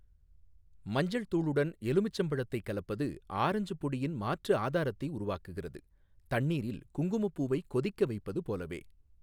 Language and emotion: Tamil, neutral